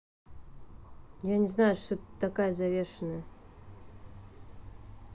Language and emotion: Russian, neutral